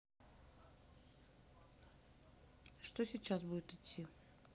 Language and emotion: Russian, neutral